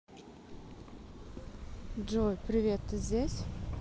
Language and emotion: Russian, neutral